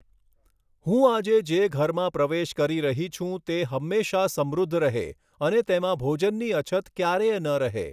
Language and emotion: Gujarati, neutral